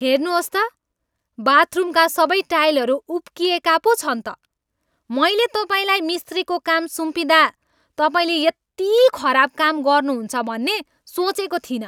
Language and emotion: Nepali, angry